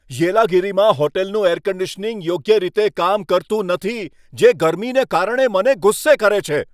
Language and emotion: Gujarati, angry